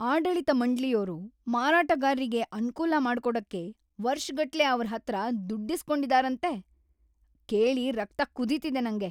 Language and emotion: Kannada, angry